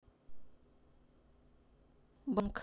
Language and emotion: Russian, neutral